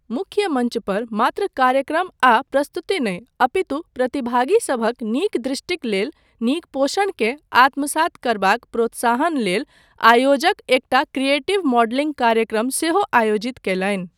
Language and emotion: Maithili, neutral